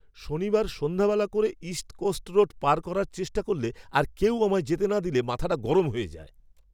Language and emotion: Bengali, angry